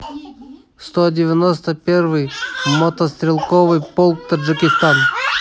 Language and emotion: Russian, neutral